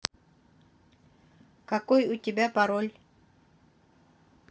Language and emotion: Russian, neutral